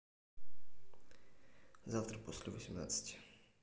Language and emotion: Russian, neutral